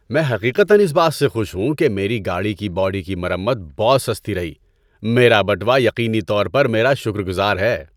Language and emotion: Urdu, happy